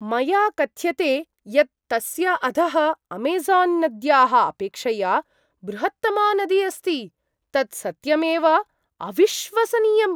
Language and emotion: Sanskrit, surprised